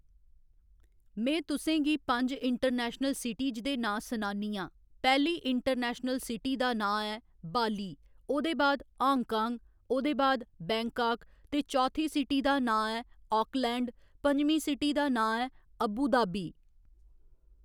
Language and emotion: Dogri, neutral